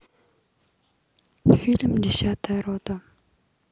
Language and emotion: Russian, neutral